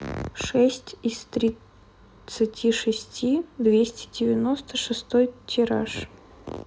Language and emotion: Russian, neutral